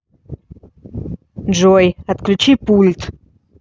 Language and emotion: Russian, neutral